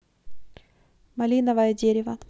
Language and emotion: Russian, neutral